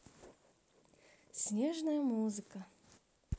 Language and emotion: Russian, positive